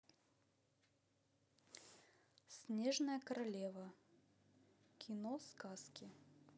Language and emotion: Russian, neutral